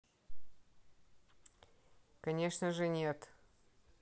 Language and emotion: Russian, neutral